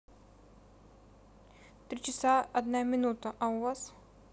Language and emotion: Russian, neutral